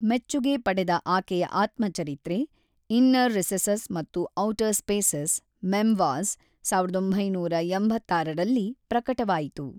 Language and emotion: Kannada, neutral